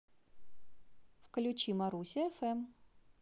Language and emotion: Russian, positive